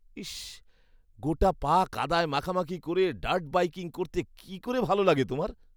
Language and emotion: Bengali, disgusted